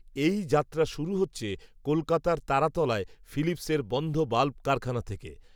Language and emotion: Bengali, neutral